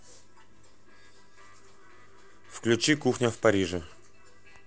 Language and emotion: Russian, neutral